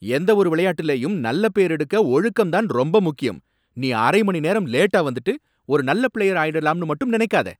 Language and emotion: Tamil, angry